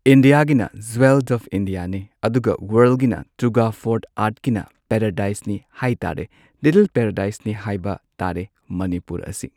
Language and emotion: Manipuri, neutral